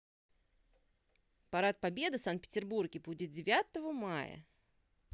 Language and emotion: Russian, neutral